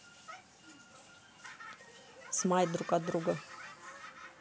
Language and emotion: Russian, neutral